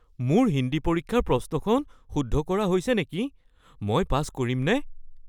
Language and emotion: Assamese, fearful